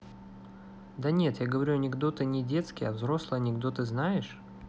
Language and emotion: Russian, neutral